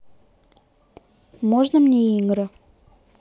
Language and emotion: Russian, neutral